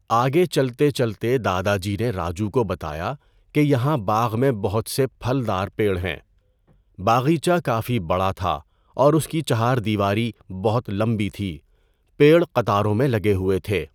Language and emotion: Urdu, neutral